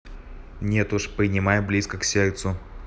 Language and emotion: Russian, neutral